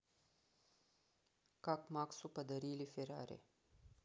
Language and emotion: Russian, neutral